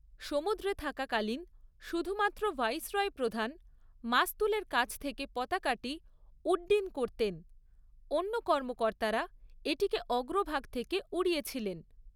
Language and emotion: Bengali, neutral